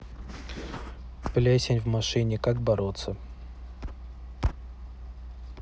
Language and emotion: Russian, neutral